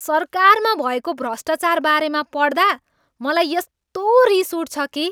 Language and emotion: Nepali, angry